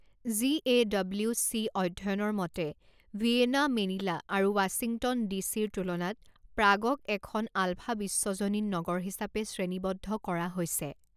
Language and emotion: Assamese, neutral